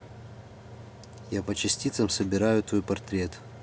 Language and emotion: Russian, neutral